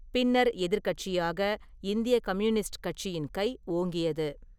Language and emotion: Tamil, neutral